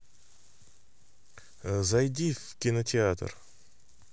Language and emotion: Russian, neutral